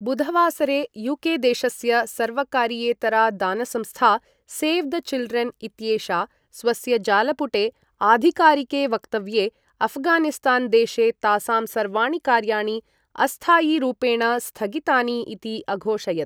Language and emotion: Sanskrit, neutral